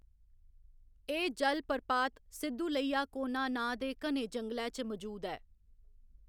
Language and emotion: Dogri, neutral